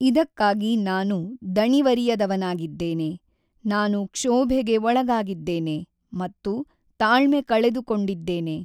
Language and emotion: Kannada, neutral